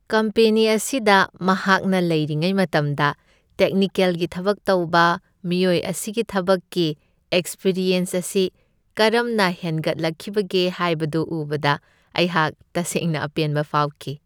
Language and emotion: Manipuri, happy